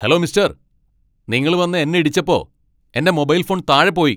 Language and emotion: Malayalam, angry